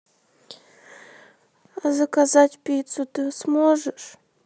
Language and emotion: Russian, sad